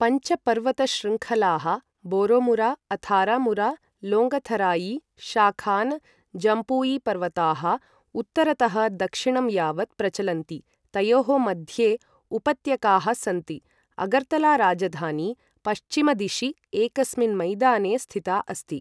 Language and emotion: Sanskrit, neutral